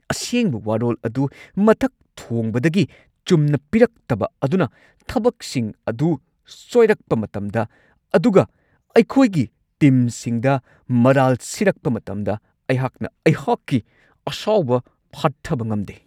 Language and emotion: Manipuri, angry